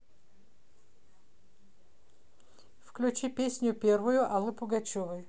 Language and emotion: Russian, neutral